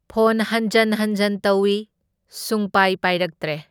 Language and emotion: Manipuri, neutral